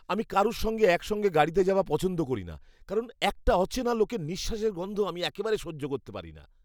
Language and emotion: Bengali, disgusted